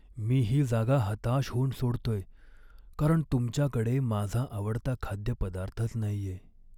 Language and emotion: Marathi, sad